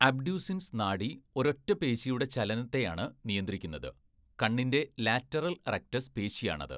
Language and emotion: Malayalam, neutral